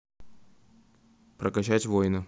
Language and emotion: Russian, neutral